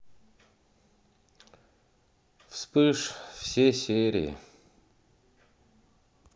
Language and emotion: Russian, sad